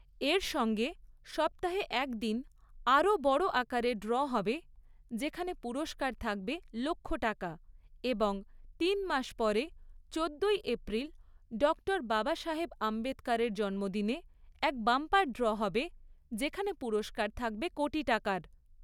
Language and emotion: Bengali, neutral